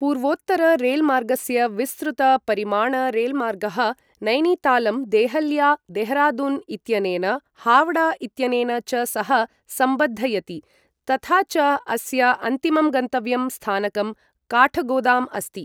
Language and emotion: Sanskrit, neutral